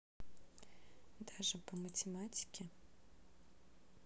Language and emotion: Russian, neutral